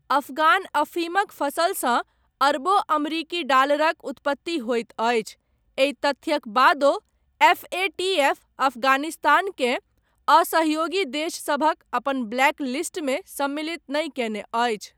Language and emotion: Maithili, neutral